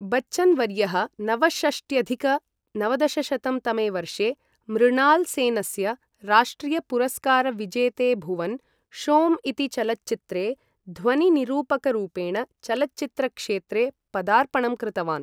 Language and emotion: Sanskrit, neutral